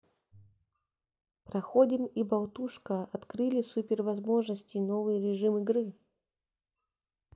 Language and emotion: Russian, neutral